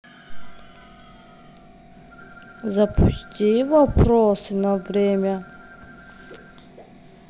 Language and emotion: Russian, neutral